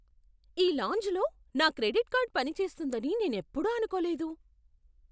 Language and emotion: Telugu, surprised